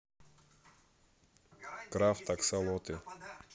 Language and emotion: Russian, neutral